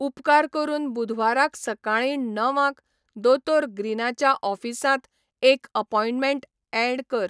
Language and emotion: Goan Konkani, neutral